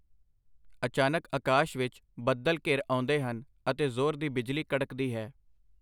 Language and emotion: Punjabi, neutral